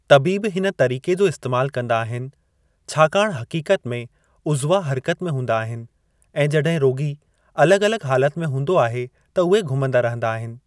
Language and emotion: Sindhi, neutral